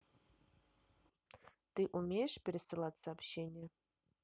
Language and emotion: Russian, neutral